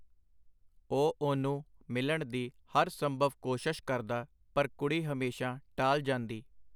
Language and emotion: Punjabi, neutral